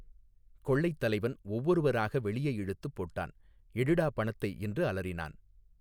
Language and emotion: Tamil, neutral